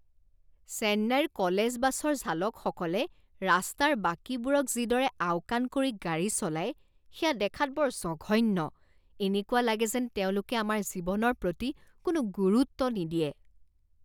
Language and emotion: Assamese, disgusted